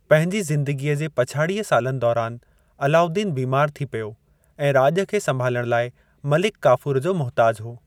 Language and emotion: Sindhi, neutral